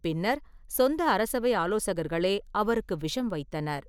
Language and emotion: Tamil, neutral